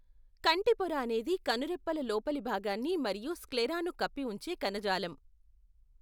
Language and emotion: Telugu, neutral